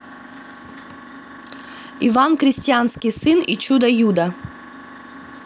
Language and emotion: Russian, neutral